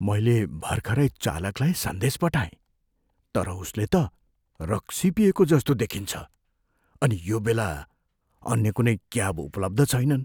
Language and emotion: Nepali, fearful